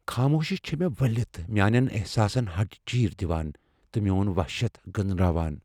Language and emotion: Kashmiri, fearful